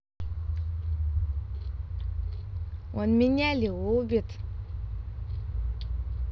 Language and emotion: Russian, positive